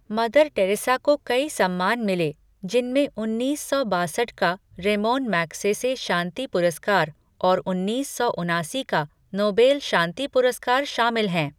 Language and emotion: Hindi, neutral